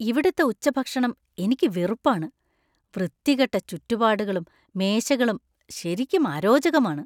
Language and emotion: Malayalam, disgusted